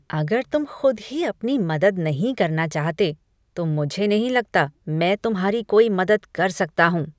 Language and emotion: Hindi, disgusted